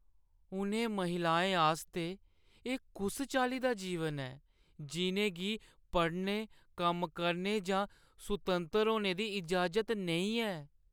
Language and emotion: Dogri, sad